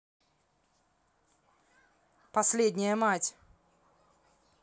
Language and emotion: Russian, angry